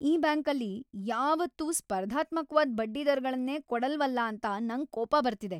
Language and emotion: Kannada, angry